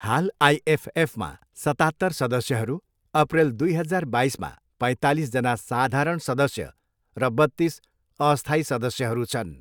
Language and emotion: Nepali, neutral